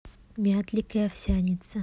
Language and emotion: Russian, neutral